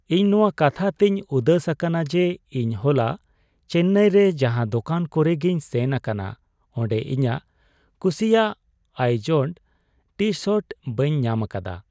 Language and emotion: Santali, sad